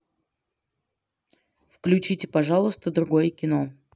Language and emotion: Russian, neutral